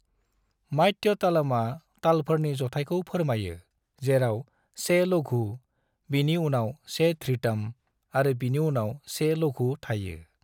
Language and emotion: Bodo, neutral